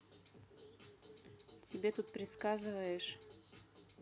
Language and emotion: Russian, neutral